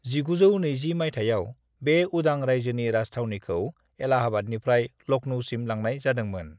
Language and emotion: Bodo, neutral